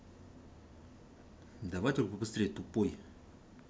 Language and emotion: Russian, angry